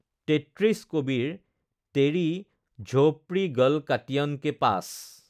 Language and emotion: Assamese, neutral